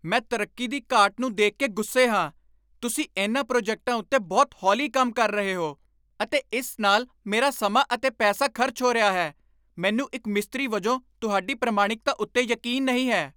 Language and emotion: Punjabi, angry